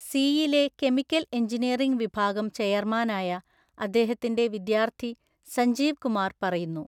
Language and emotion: Malayalam, neutral